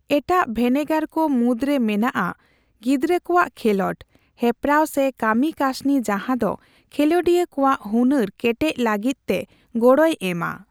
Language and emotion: Santali, neutral